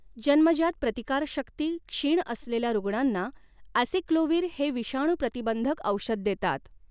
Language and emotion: Marathi, neutral